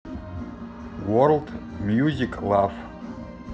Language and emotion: Russian, neutral